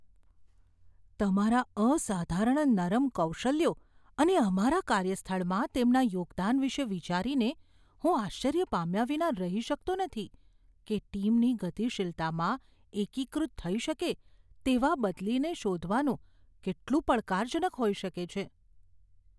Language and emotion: Gujarati, fearful